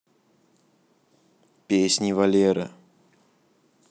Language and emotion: Russian, neutral